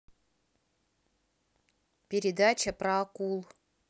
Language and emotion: Russian, neutral